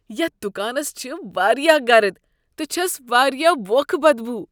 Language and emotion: Kashmiri, disgusted